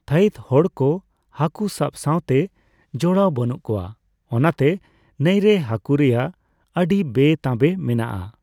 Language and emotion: Santali, neutral